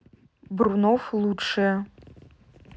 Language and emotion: Russian, neutral